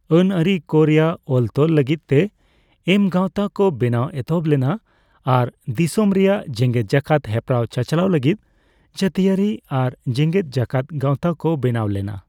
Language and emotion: Santali, neutral